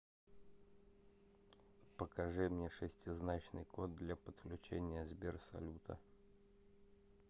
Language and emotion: Russian, neutral